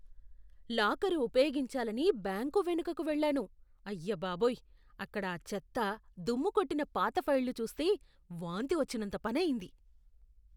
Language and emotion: Telugu, disgusted